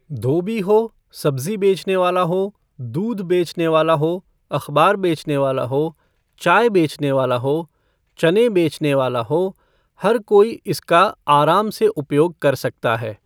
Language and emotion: Hindi, neutral